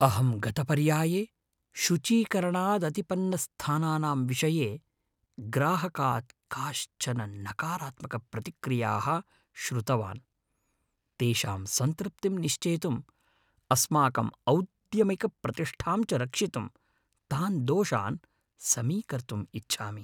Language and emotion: Sanskrit, fearful